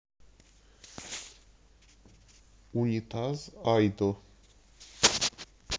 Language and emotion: Russian, neutral